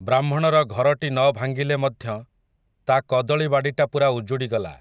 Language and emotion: Odia, neutral